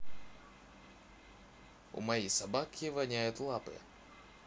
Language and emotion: Russian, neutral